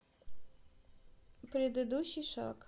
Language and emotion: Russian, neutral